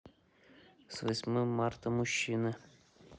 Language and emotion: Russian, neutral